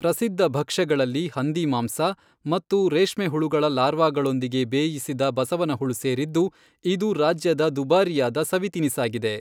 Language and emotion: Kannada, neutral